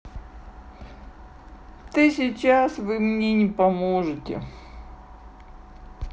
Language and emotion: Russian, sad